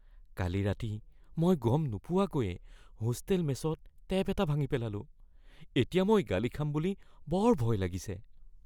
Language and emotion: Assamese, fearful